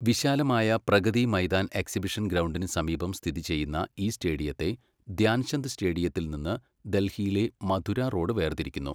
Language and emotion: Malayalam, neutral